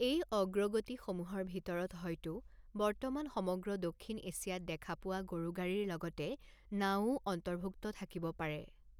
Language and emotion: Assamese, neutral